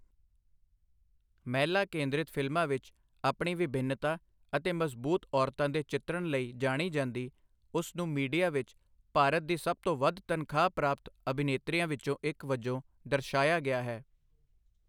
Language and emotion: Punjabi, neutral